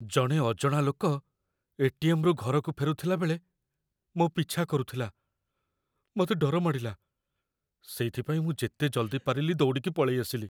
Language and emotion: Odia, fearful